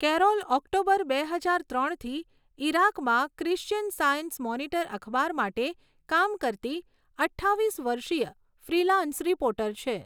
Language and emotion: Gujarati, neutral